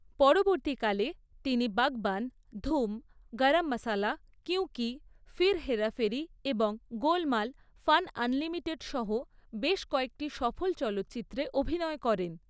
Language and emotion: Bengali, neutral